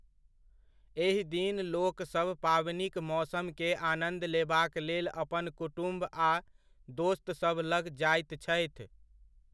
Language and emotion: Maithili, neutral